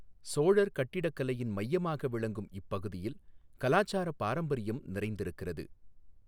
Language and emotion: Tamil, neutral